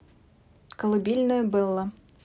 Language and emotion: Russian, neutral